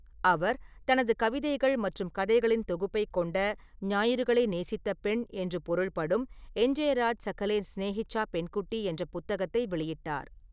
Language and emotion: Tamil, neutral